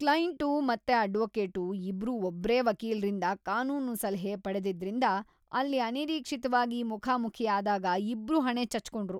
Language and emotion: Kannada, disgusted